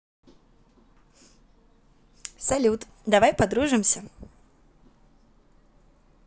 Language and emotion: Russian, positive